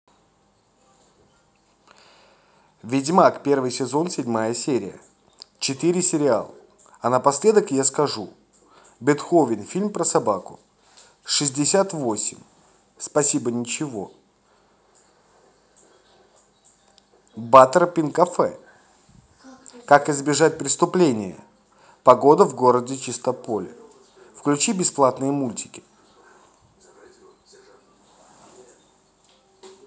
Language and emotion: Russian, neutral